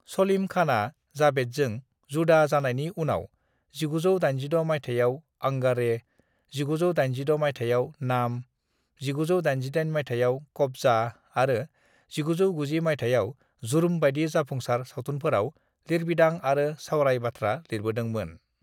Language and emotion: Bodo, neutral